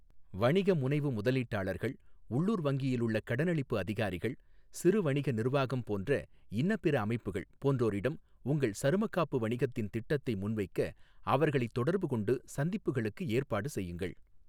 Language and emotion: Tamil, neutral